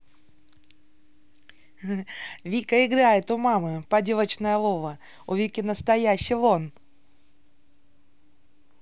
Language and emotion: Russian, positive